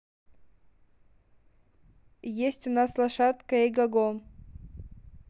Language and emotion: Russian, neutral